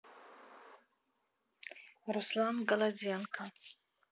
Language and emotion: Russian, neutral